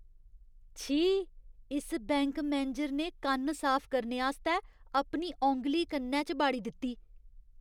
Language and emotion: Dogri, disgusted